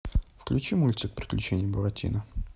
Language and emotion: Russian, neutral